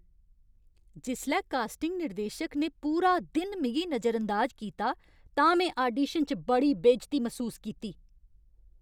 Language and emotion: Dogri, angry